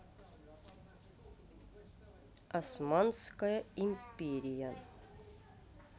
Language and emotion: Russian, neutral